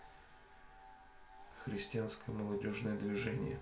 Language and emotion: Russian, neutral